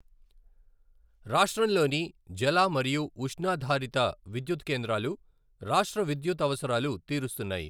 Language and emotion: Telugu, neutral